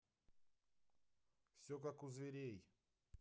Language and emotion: Russian, neutral